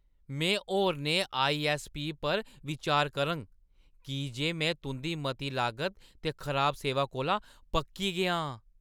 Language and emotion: Dogri, angry